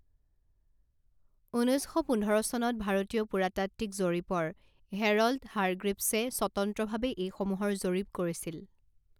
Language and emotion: Assamese, neutral